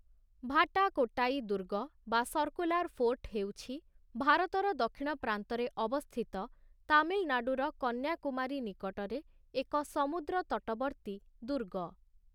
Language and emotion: Odia, neutral